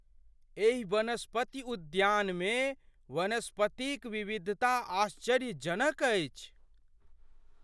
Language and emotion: Maithili, surprised